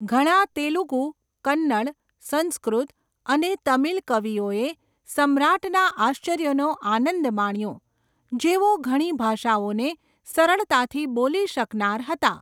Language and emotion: Gujarati, neutral